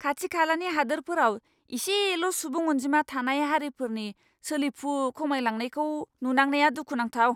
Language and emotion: Bodo, angry